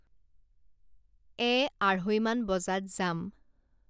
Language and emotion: Assamese, neutral